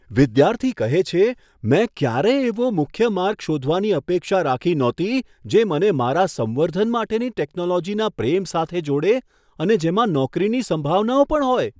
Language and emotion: Gujarati, surprised